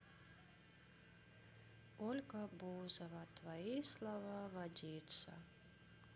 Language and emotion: Russian, sad